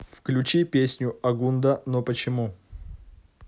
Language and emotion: Russian, neutral